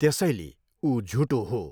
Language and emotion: Nepali, neutral